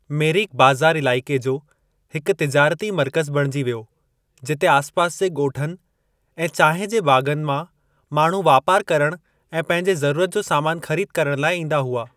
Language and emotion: Sindhi, neutral